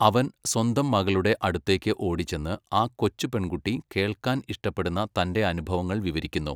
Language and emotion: Malayalam, neutral